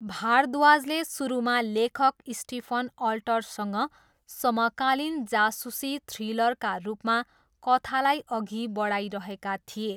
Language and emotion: Nepali, neutral